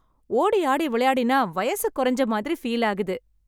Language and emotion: Tamil, happy